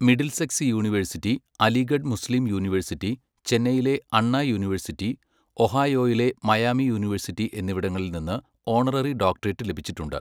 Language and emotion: Malayalam, neutral